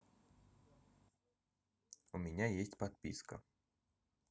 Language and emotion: Russian, neutral